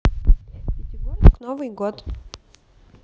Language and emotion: Russian, neutral